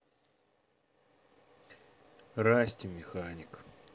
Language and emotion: Russian, neutral